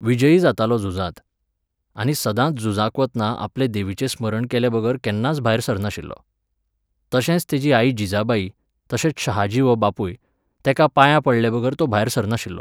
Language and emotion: Goan Konkani, neutral